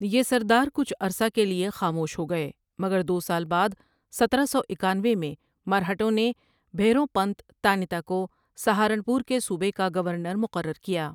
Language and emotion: Urdu, neutral